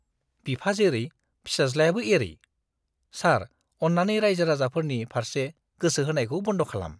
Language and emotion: Bodo, disgusted